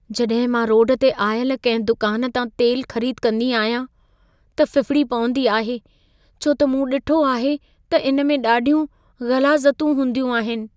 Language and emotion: Sindhi, fearful